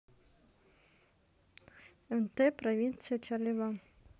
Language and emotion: Russian, neutral